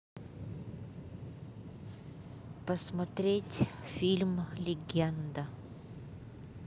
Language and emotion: Russian, neutral